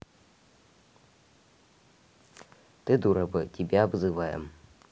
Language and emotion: Russian, neutral